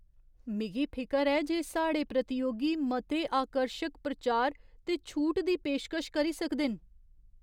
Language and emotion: Dogri, fearful